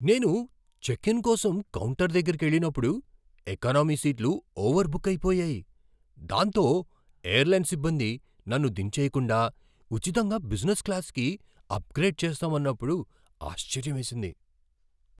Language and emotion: Telugu, surprised